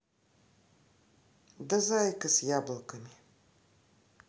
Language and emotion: Russian, neutral